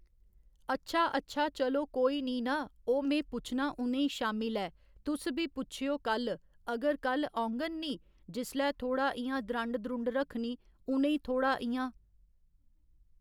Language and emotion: Dogri, neutral